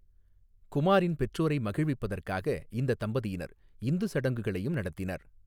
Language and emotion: Tamil, neutral